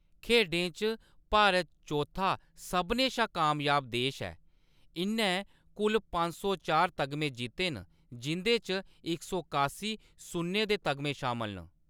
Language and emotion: Dogri, neutral